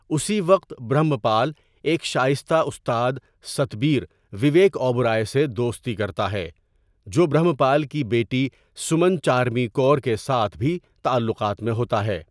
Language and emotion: Urdu, neutral